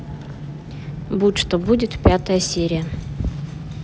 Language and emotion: Russian, neutral